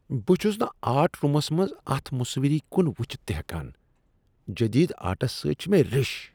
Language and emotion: Kashmiri, disgusted